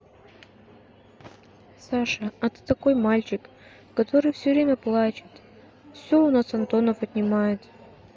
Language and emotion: Russian, sad